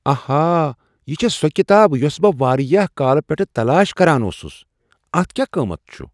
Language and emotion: Kashmiri, surprised